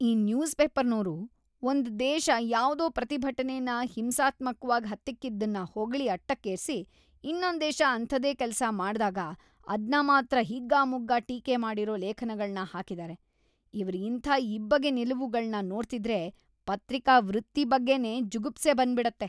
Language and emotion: Kannada, disgusted